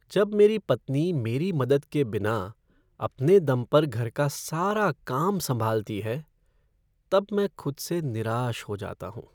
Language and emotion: Hindi, sad